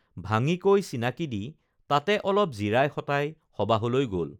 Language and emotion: Assamese, neutral